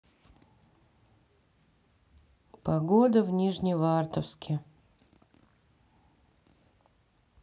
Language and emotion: Russian, sad